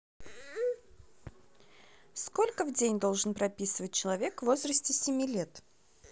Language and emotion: Russian, neutral